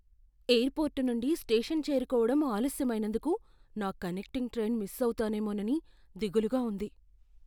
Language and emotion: Telugu, fearful